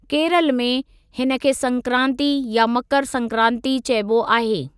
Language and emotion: Sindhi, neutral